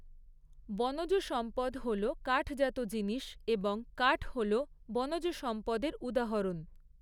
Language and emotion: Bengali, neutral